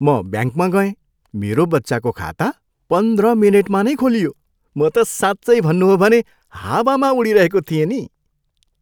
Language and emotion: Nepali, happy